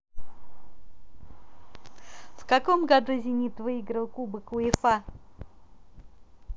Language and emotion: Russian, positive